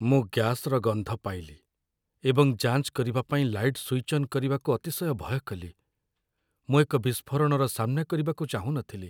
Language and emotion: Odia, fearful